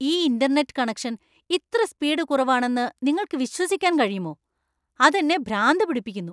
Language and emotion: Malayalam, angry